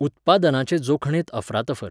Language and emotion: Goan Konkani, neutral